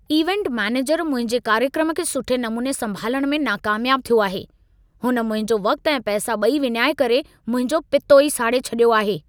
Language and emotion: Sindhi, angry